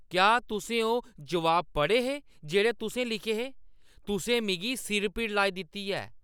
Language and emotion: Dogri, angry